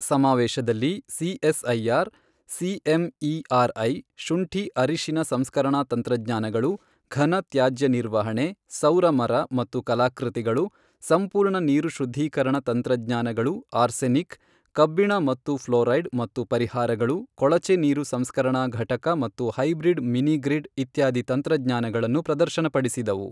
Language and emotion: Kannada, neutral